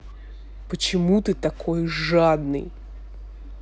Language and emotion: Russian, angry